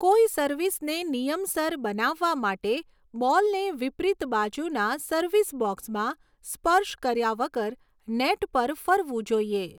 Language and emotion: Gujarati, neutral